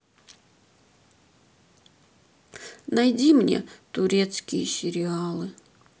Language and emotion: Russian, sad